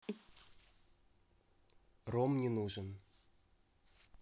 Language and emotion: Russian, neutral